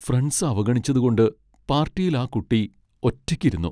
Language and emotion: Malayalam, sad